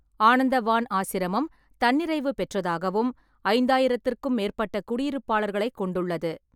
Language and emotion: Tamil, neutral